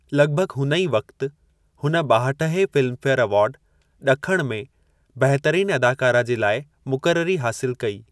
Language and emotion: Sindhi, neutral